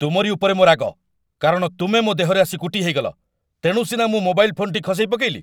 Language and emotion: Odia, angry